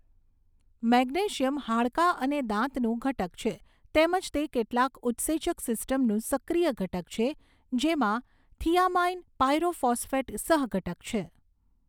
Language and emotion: Gujarati, neutral